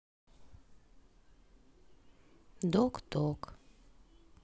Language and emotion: Russian, sad